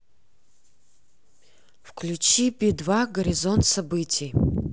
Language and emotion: Russian, neutral